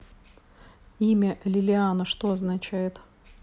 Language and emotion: Russian, neutral